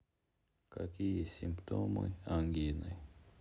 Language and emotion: Russian, sad